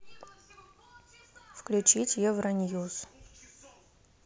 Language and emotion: Russian, neutral